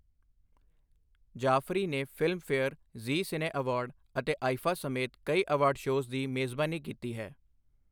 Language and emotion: Punjabi, neutral